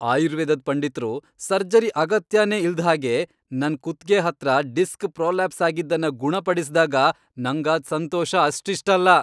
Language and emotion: Kannada, happy